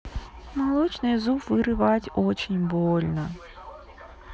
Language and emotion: Russian, sad